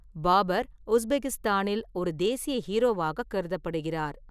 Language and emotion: Tamil, neutral